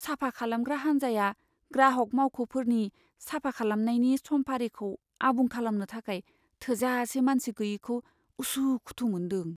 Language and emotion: Bodo, fearful